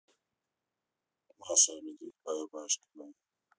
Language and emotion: Russian, neutral